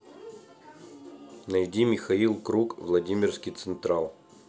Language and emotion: Russian, neutral